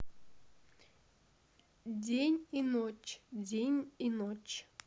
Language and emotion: Russian, neutral